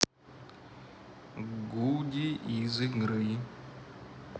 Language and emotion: Russian, neutral